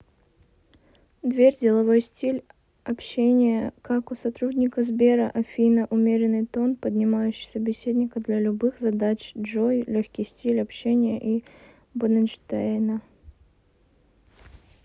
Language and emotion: Russian, neutral